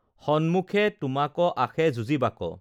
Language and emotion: Assamese, neutral